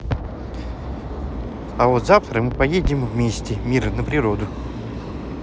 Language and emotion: Russian, positive